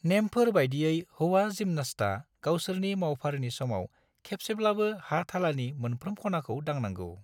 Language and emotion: Bodo, neutral